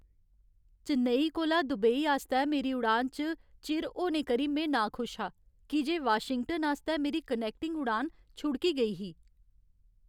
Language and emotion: Dogri, sad